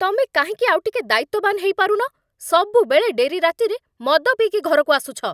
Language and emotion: Odia, angry